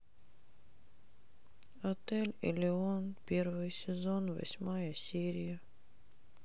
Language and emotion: Russian, sad